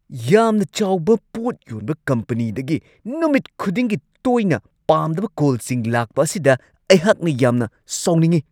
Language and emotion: Manipuri, angry